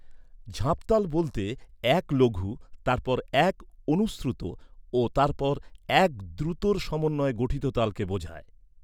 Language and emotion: Bengali, neutral